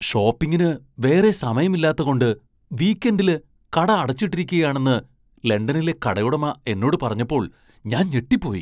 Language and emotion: Malayalam, surprised